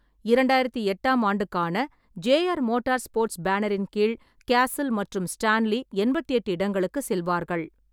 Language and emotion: Tamil, neutral